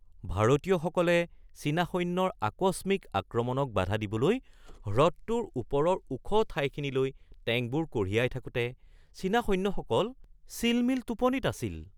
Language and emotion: Assamese, surprised